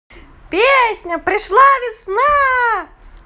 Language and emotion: Russian, positive